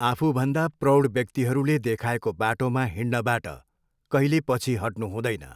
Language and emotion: Nepali, neutral